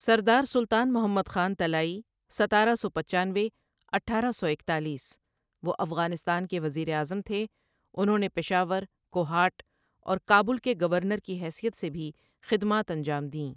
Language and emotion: Urdu, neutral